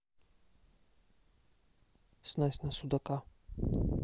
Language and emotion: Russian, neutral